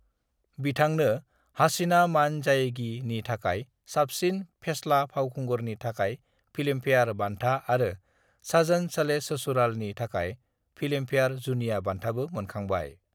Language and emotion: Bodo, neutral